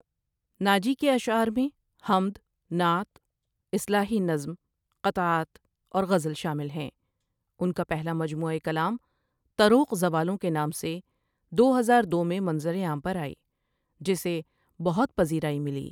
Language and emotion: Urdu, neutral